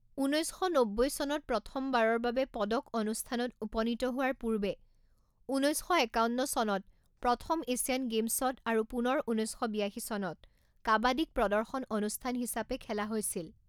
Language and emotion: Assamese, neutral